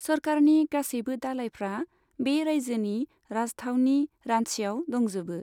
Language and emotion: Bodo, neutral